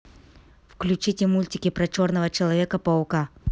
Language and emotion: Russian, neutral